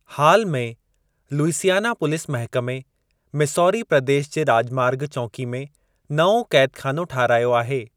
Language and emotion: Sindhi, neutral